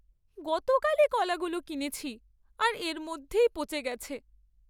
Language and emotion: Bengali, sad